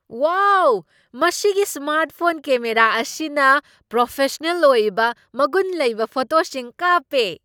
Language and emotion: Manipuri, surprised